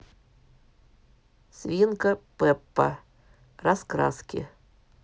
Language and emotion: Russian, neutral